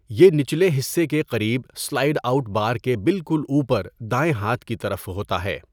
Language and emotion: Urdu, neutral